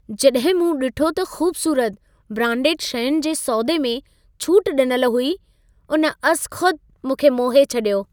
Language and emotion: Sindhi, happy